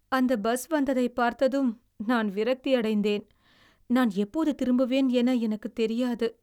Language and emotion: Tamil, sad